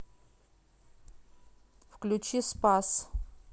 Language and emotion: Russian, neutral